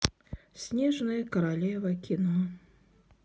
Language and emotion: Russian, sad